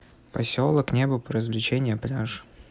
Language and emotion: Russian, neutral